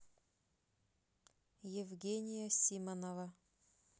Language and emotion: Russian, neutral